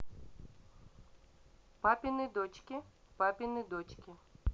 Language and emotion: Russian, neutral